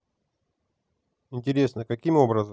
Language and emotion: Russian, neutral